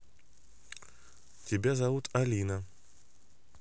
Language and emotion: Russian, neutral